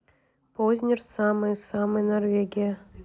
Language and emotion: Russian, neutral